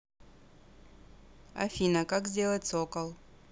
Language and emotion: Russian, neutral